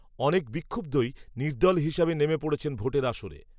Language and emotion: Bengali, neutral